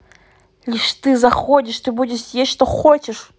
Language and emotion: Russian, angry